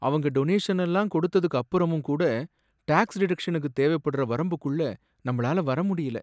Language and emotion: Tamil, sad